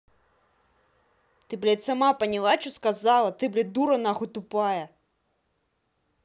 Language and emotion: Russian, angry